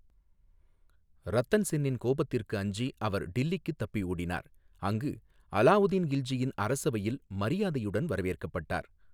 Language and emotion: Tamil, neutral